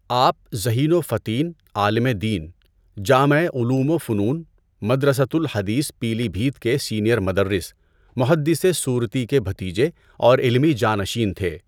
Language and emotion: Urdu, neutral